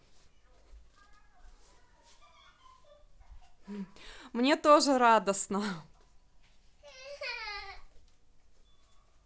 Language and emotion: Russian, positive